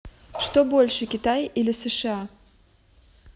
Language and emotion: Russian, neutral